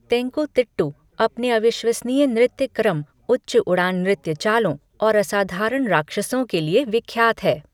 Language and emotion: Hindi, neutral